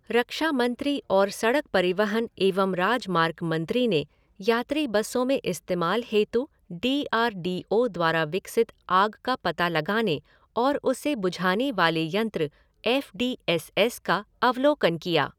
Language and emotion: Hindi, neutral